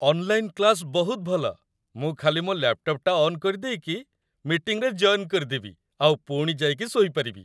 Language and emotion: Odia, happy